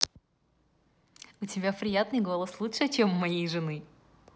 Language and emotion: Russian, positive